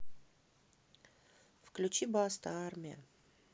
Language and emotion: Russian, neutral